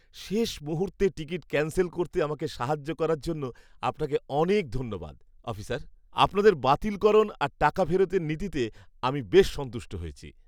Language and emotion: Bengali, happy